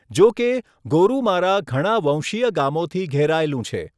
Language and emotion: Gujarati, neutral